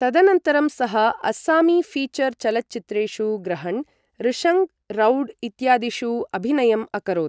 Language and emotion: Sanskrit, neutral